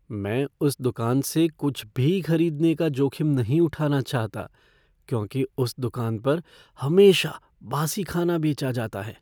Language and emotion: Hindi, fearful